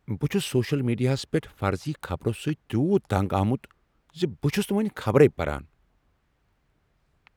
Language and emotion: Kashmiri, angry